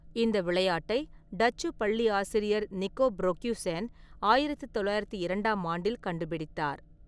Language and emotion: Tamil, neutral